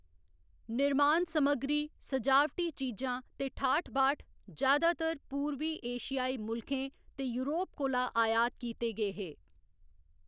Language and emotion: Dogri, neutral